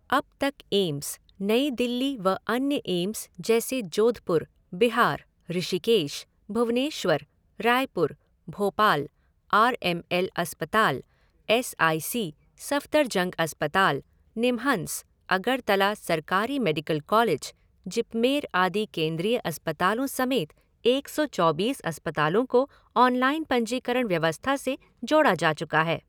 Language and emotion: Hindi, neutral